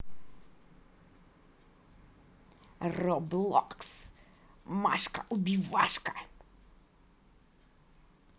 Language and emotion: Russian, angry